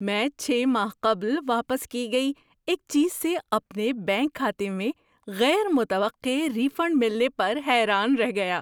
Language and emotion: Urdu, surprised